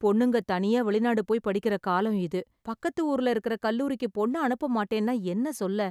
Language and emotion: Tamil, sad